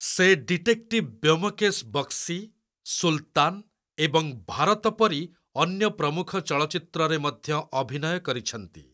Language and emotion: Odia, neutral